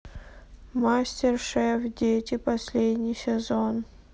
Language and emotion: Russian, sad